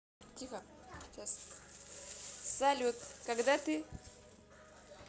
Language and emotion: Russian, positive